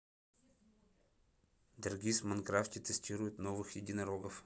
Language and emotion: Russian, neutral